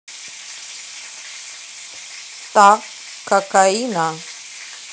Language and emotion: Russian, neutral